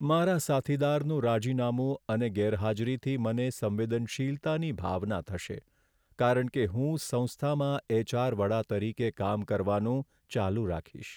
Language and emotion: Gujarati, sad